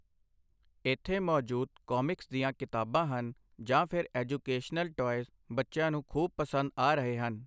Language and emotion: Punjabi, neutral